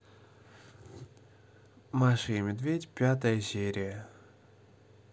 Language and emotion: Russian, neutral